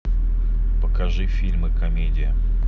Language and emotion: Russian, neutral